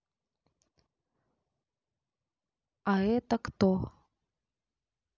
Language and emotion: Russian, neutral